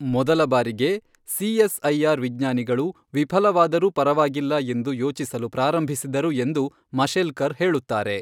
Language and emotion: Kannada, neutral